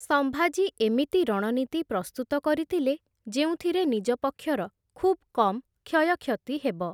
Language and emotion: Odia, neutral